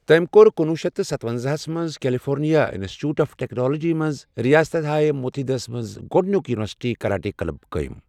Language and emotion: Kashmiri, neutral